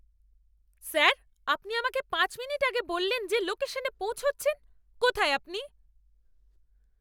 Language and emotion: Bengali, angry